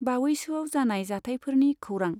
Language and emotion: Bodo, neutral